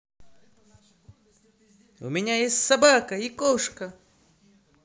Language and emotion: Russian, positive